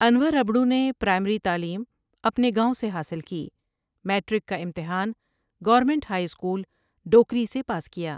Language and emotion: Urdu, neutral